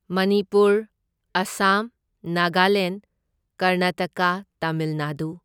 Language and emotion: Manipuri, neutral